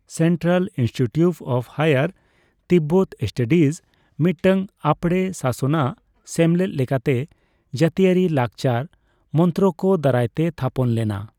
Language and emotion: Santali, neutral